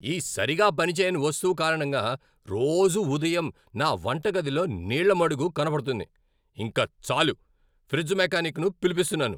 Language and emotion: Telugu, angry